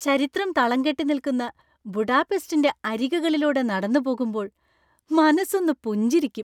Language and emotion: Malayalam, happy